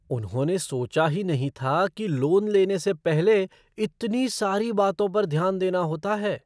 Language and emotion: Hindi, surprised